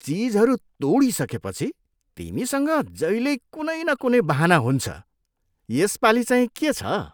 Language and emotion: Nepali, disgusted